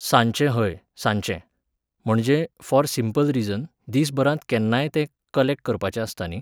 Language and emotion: Goan Konkani, neutral